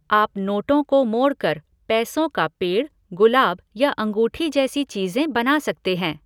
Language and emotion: Hindi, neutral